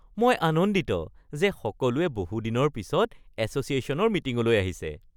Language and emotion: Assamese, happy